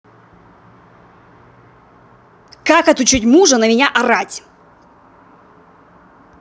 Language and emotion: Russian, angry